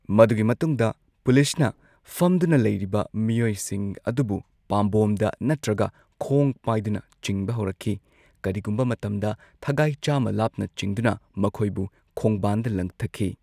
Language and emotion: Manipuri, neutral